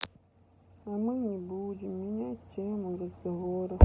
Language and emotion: Russian, sad